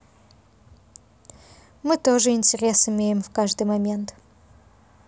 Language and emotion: Russian, neutral